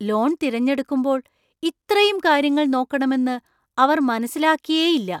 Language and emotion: Malayalam, surprised